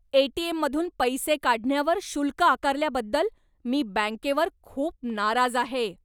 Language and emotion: Marathi, angry